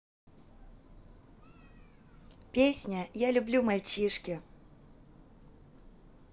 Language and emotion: Russian, positive